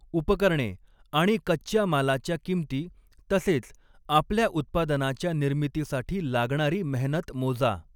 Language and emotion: Marathi, neutral